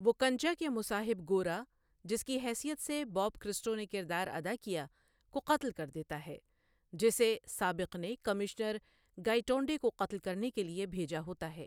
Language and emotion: Urdu, neutral